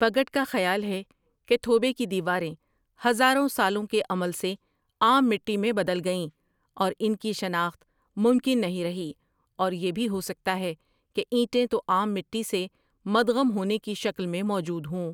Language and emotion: Urdu, neutral